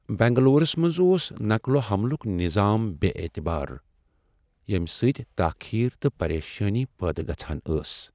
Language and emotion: Kashmiri, sad